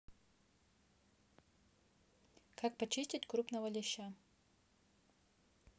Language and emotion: Russian, neutral